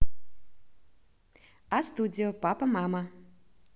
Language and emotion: Russian, positive